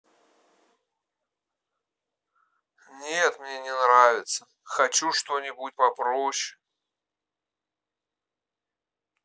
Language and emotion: Russian, neutral